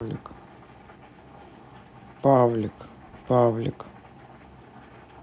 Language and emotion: Russian, neutral